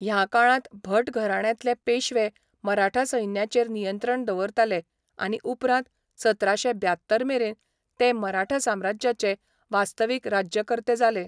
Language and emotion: Goan Konkani, neutral